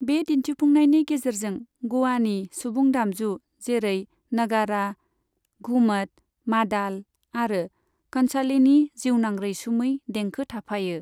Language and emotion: Bodo, neutral